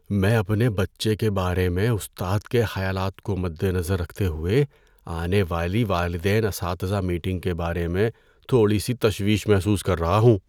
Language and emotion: Urdu, fearful